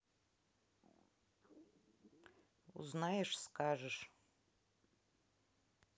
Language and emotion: Russian, neutral